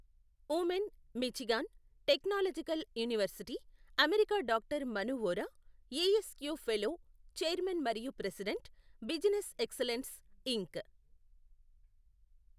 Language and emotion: Telugu, neutral